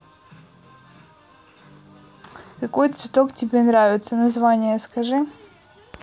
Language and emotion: Russian, neutral